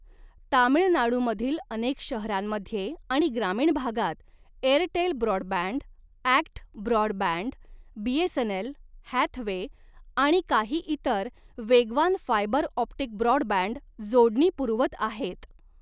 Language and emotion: Marathi, neutral